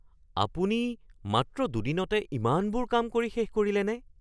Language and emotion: Assamese, surprised